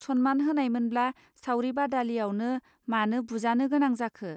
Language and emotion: Bodo, neutral